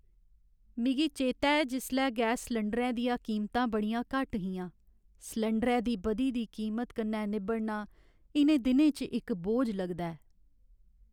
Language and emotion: Dogri, sad